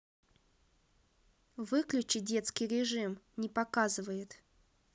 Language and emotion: Russian, neutral